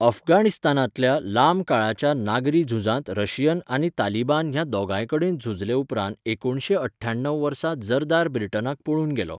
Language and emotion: Goan Konkani, neutral